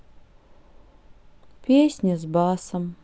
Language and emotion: Russian, sad